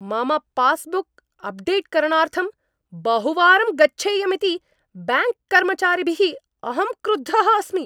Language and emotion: Sanskrit, angry